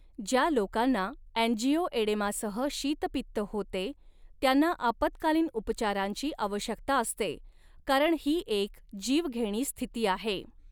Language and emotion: Marathi, neutral